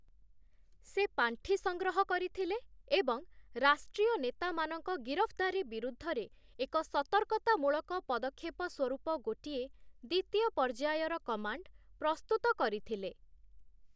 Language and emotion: Odia, neutral